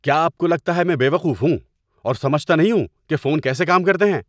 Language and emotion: Urdu, angry